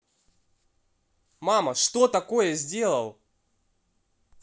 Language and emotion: Russian, angry